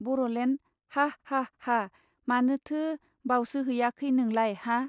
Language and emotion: Bodo, neutral